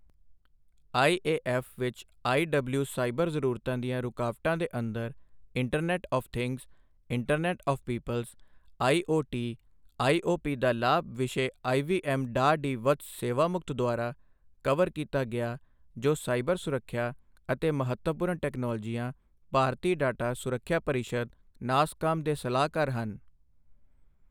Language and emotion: Punjabi, neutral